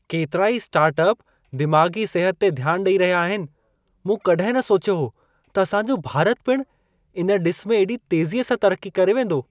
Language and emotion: Sindhi, surprised